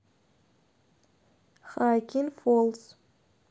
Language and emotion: Russian, neutral